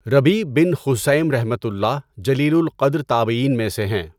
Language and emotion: Urdu, neutral